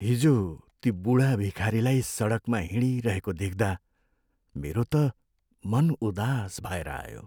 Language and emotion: Nepali, sad